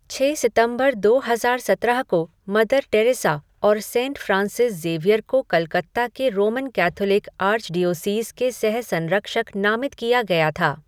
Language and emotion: Hindi, neutral